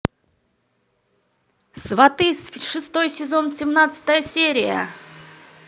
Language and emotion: Russian, positive